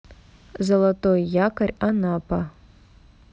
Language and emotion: Russian, neutral